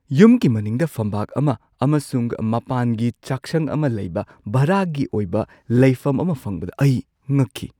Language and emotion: Manipuri, surprised